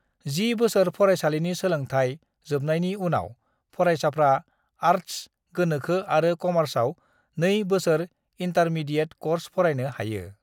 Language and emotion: Bodo, neutral